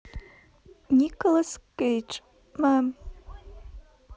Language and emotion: Russian, neutral